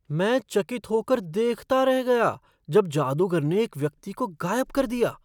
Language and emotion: Hindi, surprised